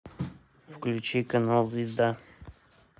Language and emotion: Russian, neutral